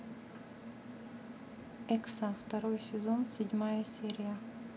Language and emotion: Russian, neutral